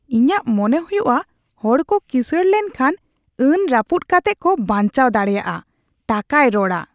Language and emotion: Santali, disgusted